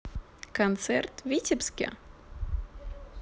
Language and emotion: Russian, positive